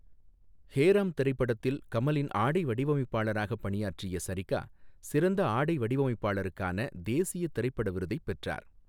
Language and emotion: Tamil, neutral